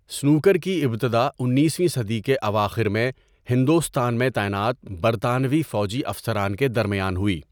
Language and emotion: Urdu, neutral